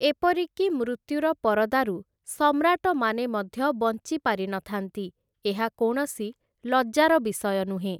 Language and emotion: Odia, neutral